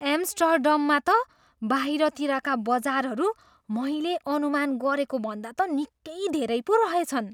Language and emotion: Nepali, surprised